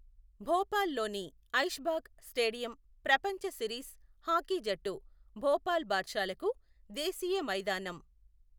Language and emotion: Telugu, neutral